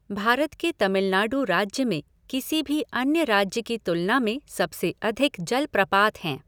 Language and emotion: Hindi, neutral